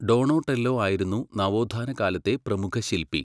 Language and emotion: Malayalam, neutral